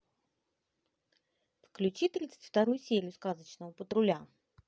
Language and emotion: Russian, positive